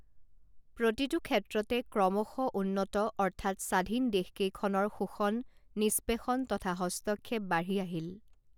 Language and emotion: Assamese, neutral